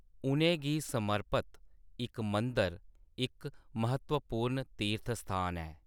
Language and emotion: Dogri, neutral